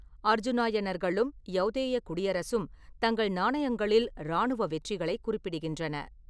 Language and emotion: Tamil, neutral